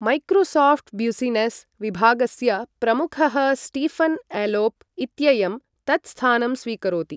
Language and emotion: Sanskrit, neutral